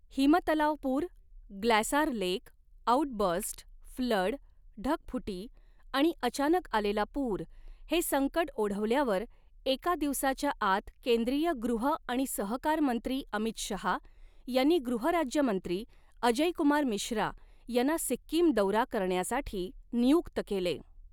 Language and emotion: Marathi, neutral